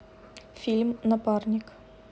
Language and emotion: Russian, neutral